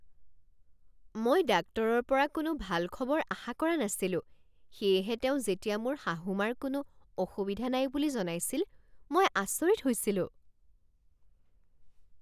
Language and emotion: Assamese, surprised